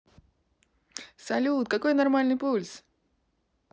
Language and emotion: Russian, positive